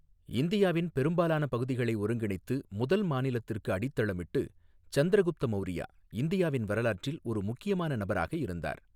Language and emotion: Tamil, neutral